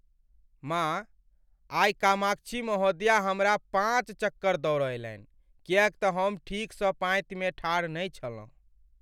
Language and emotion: Maithili, sad